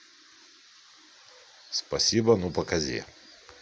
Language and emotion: Russian, neutral